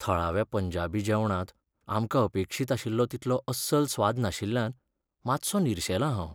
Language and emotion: Goan Konkani, sad